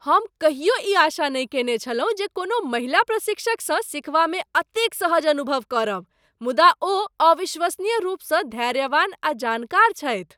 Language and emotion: Maithili, surprised